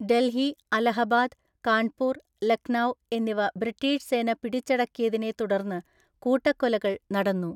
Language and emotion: Malayalam, neutral